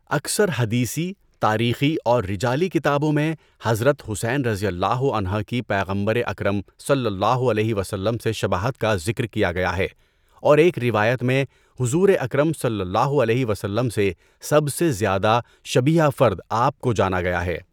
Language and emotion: Urdu, neutral